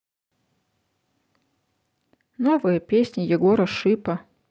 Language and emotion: Russian, neutral